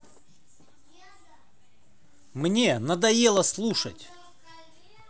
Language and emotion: Russian, angry